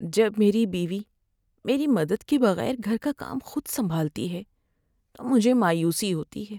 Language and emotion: Urdu, sad